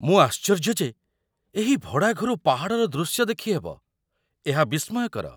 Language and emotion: Odia, surprised